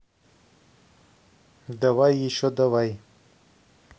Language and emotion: Russian, neutral